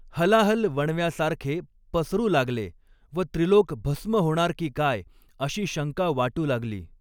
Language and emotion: Marathi, neutral